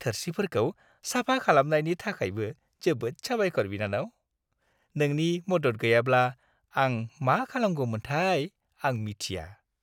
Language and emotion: Bodo, happy